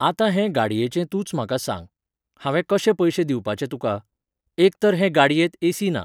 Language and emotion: Goan Konkani, neutral